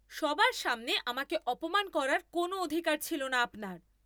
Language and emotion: Bengali, angry